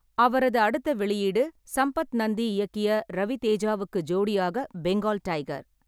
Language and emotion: Tamil, neutral